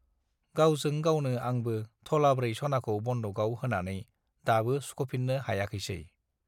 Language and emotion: Bodo, neutral